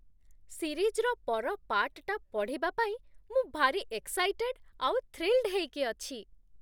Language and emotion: Odia, happy